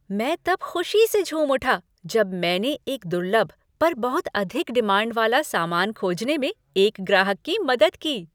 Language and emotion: Hindi, happy